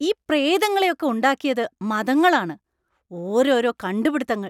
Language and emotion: Malayalam, angry